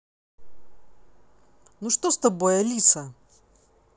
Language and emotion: Russian, angry